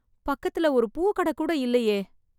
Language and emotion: Tamil, sad